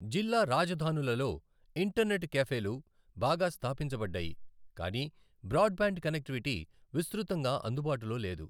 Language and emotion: Telugu, neutral